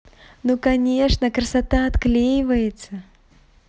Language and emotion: Russian, positive